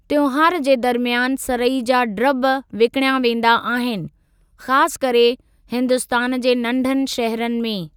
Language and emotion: Sindhi, neutral